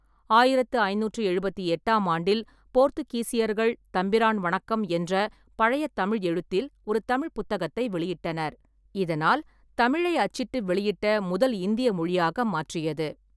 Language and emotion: Tamil, neutral